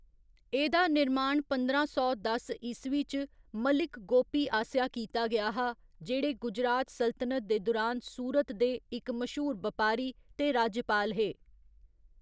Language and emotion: Dogri, neutral